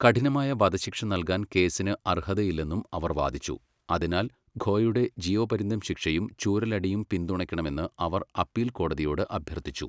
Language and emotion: Malayalam, neutral